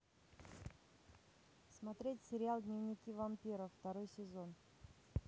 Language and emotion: Russian, neutral